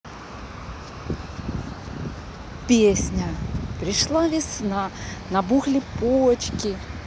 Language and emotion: Russian, neutral